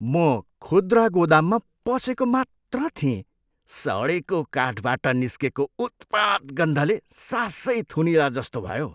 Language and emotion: Nepali, disgusted